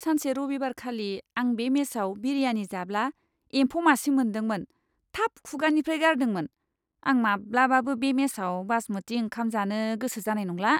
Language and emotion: Bodo, disgusted